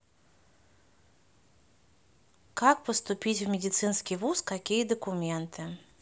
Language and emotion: Russian, neutral